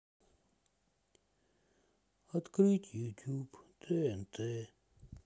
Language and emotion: Russian, sad